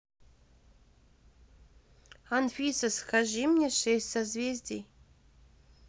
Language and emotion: Russian, neutral